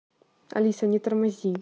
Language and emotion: Russian, angry